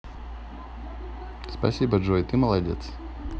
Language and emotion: Russian, positive